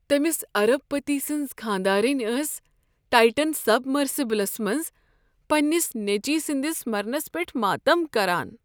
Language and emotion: Kashmiri, sad